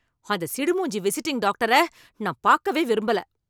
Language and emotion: Tamil, angry